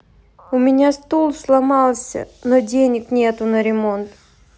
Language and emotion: Russian, sad